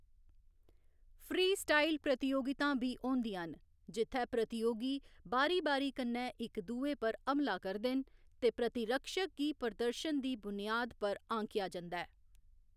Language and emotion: Dogri, neutral